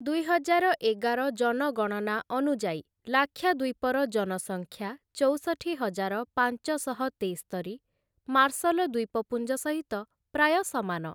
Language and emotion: Odia, neutral